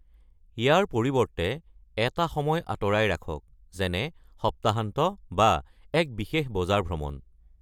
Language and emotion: Assamese, neutral